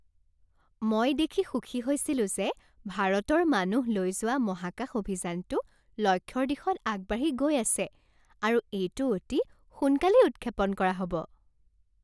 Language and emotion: Assamese, happy